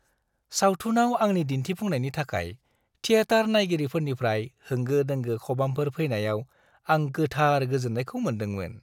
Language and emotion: Bodo, happy